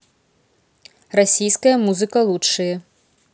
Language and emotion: Russian, neutral